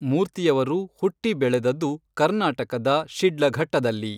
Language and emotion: Kannada, neutral